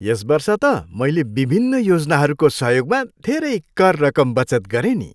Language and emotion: Nepali, happy